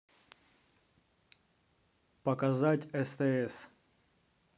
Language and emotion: Russian, neutral